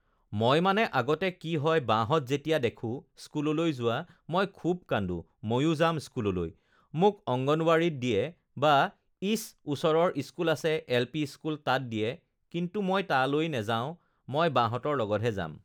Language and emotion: Assamese, neutral